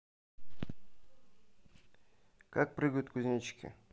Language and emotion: Russian, neutral